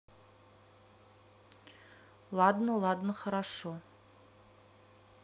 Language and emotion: Russian, neutral